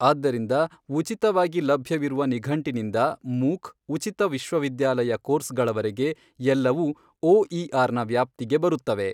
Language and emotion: Kannada, neutral